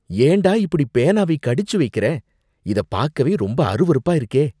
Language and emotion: Tamil, disgusted